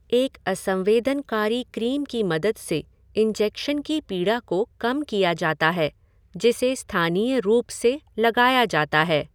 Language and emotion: Hindi, neutral